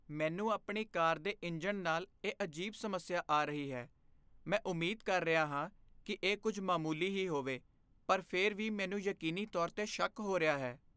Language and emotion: Punjabi, fearful